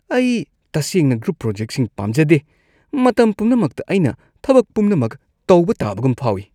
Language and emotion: Manipuri, disgusted